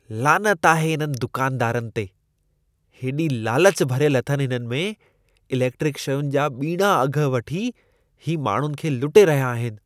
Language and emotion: Sindhi, disgusted